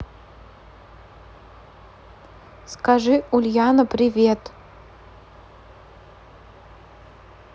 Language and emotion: Russian, neutral